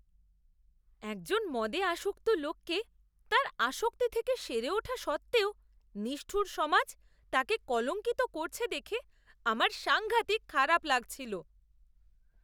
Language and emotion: Bengali, disgusted